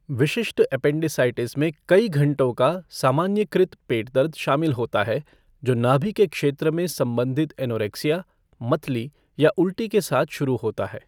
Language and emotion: Hindi, neutral